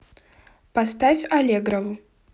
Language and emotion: Russian, neutral